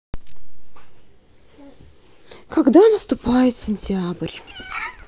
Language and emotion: Russian, sad